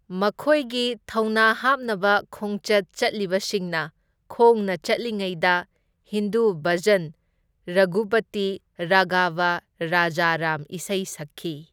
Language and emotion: Manipuri, neutral